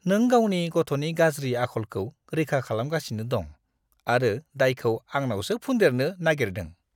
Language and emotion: Bodo, disgusted